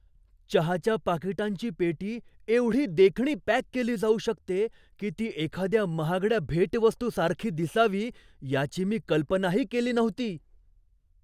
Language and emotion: Marathi, surprised